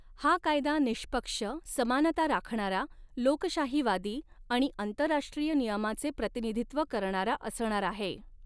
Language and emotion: Marathi, neutral